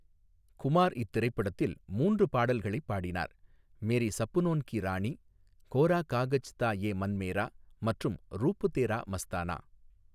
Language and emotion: Tamil, neutral